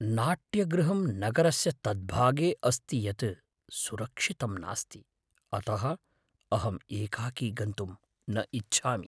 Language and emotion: Sanskrit, fearful